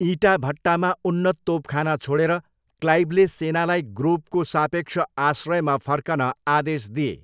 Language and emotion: Nepali, neutral